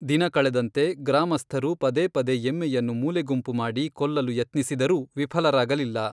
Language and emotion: Kannada, neutral